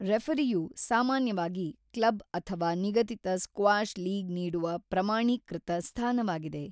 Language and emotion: Kannada, neutral